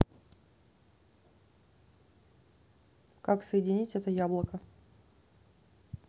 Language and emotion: Russian, neutral